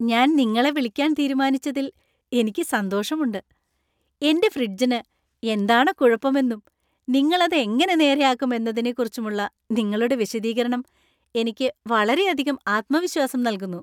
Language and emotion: Malayalam, happy